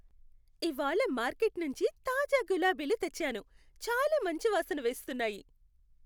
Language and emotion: Telugu, happy